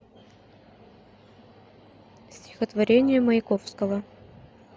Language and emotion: Russian, neutral